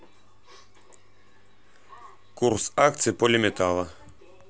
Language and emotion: Russian, neutral